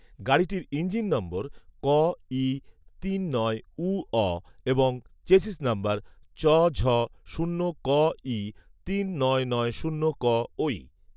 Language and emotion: Bengali, neutral